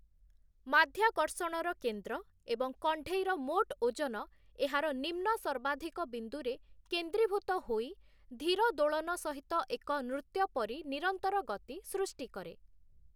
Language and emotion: Odia, neutral